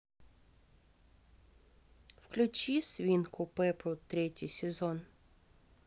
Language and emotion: Russian, neutral